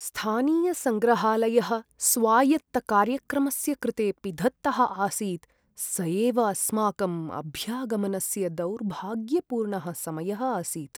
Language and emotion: Sanskrit, sad